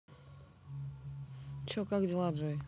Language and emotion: Russian, neutral